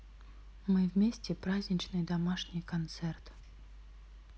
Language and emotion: Russian, neutral